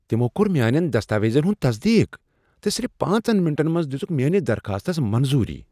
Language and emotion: Kashmiri, surprised